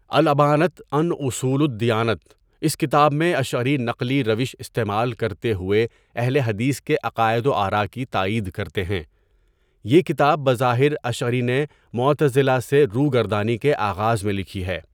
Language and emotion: Urdu, neutral